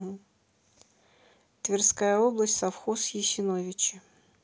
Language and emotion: Russian, neutral